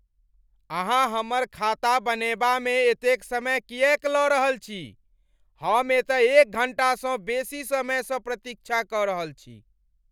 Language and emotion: Maithili, angry